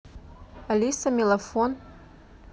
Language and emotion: Russian, neutral